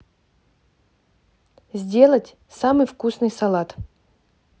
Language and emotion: Russian, neutral